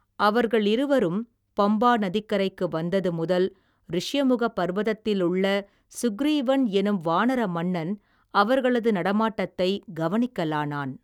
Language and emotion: Tamil, neutral